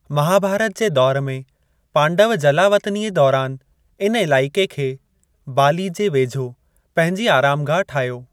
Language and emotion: Sindhi, neutral